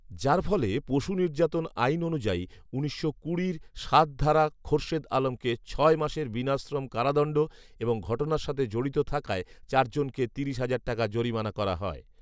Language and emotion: Bengali, neutral